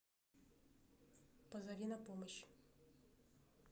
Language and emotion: Russian, neutral